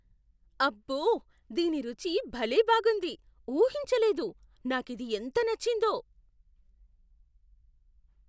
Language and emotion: Telugu, surprised